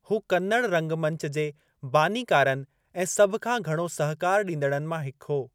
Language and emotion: Sindhi, neutral